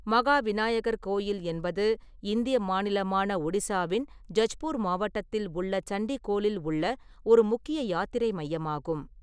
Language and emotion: Tamil, neutral